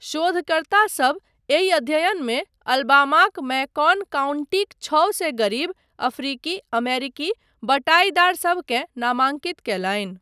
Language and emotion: Maithili, neutral